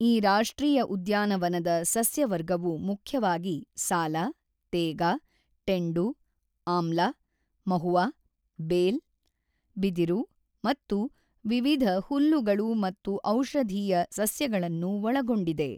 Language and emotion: Kannada, neutral